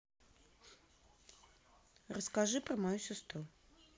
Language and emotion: Russian, neutral